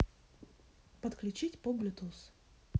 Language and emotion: Russian, neutral